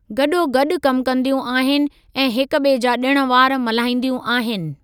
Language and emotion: Sindhi, neutral